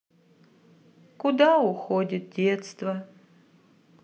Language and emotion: Russian, sad